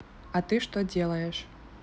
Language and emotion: Russian, neutral